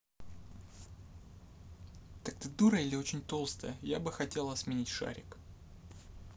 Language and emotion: Russian, angry